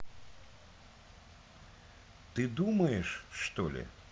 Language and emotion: Russian, neutral